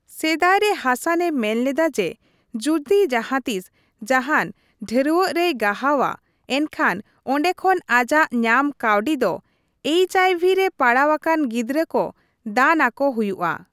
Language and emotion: Santali, neutral